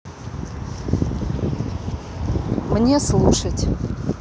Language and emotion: Russian, neutral